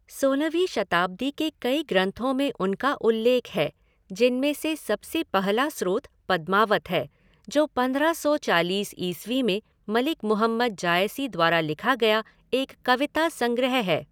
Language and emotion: Hindi, neutral